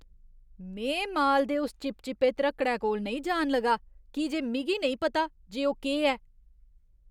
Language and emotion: Dogri, disgusted